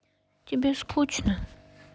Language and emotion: Russian, sad